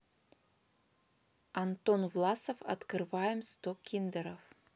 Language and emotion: Russian, neutral